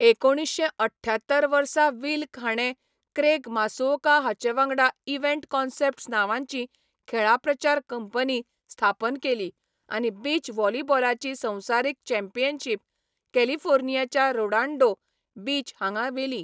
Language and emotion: Goan Konkani, neutral